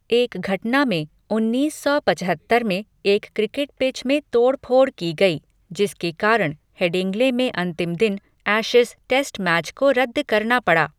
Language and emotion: Hindi, neutral